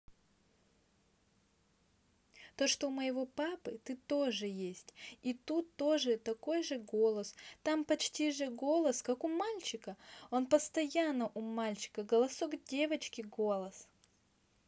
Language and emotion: Russian, neutral